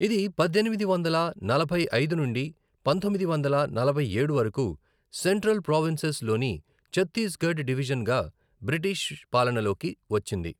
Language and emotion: Telugu, neutral